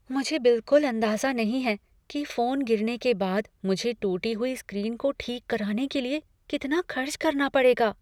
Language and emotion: Hindi, fearful